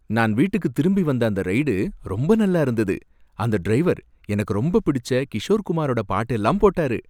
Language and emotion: Tamil, happy